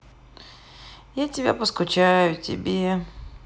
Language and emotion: Russian, sad